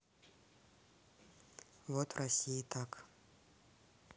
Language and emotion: Russian, neutral